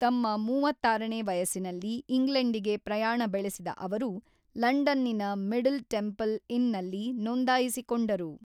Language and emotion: Kannada, neutral